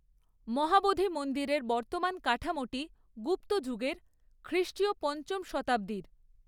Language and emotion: Bengali, neutral